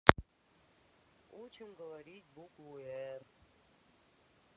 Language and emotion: Russian, sad